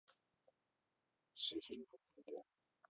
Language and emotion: Russian, neutral